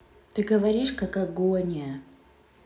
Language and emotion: Russian, neutral